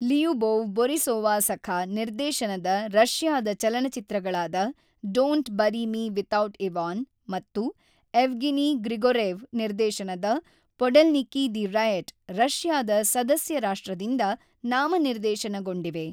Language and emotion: Kannada, neutral